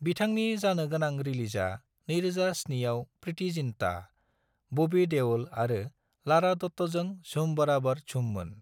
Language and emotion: Bodo, neutral